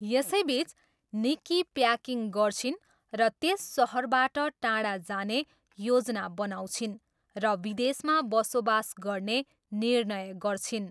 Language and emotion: Nepali, neutral